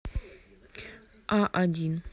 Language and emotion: Russian, neutral